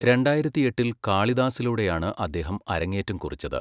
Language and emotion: Malayalam, neutral